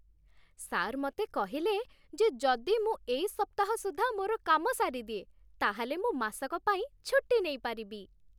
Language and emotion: Odia, happy